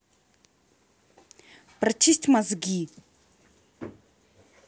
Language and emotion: Russian, angry